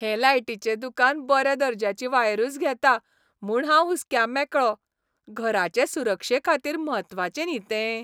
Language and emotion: Goan Konkani, happy